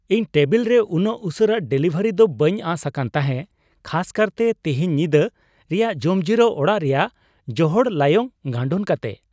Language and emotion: Santali, surprised